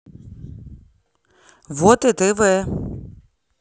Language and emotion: Russian, neutral